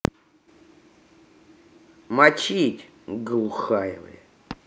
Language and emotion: Russian, angry